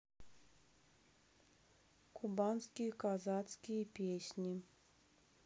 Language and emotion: Russian, neutral